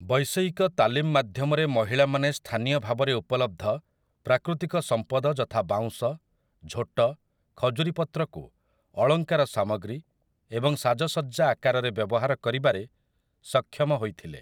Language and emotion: Odia, neutral